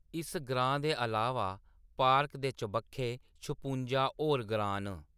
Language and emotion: Dogri, neutral